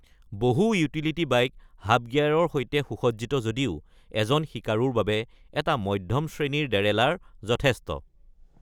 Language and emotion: Assamese, neutral